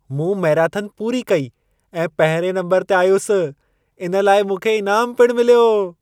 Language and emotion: Sindhi, happy